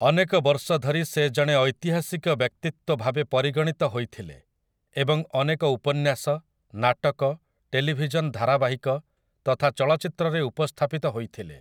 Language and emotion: Odia, neutral